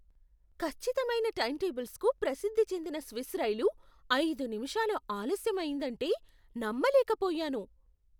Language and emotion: Telugu, surprised